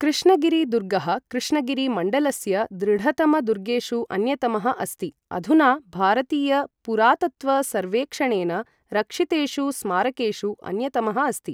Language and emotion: Sanskrit, neutral